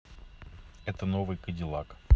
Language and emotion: Russian, neutral